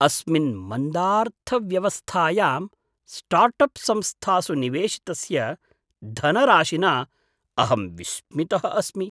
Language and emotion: Sanskrit, surprised